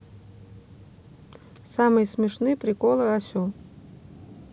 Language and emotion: Russian, neutral